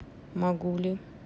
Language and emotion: Russian, neutral